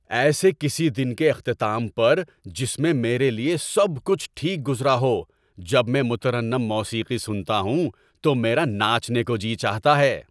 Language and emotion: Urdu, happy